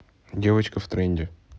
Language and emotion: Russian, neutral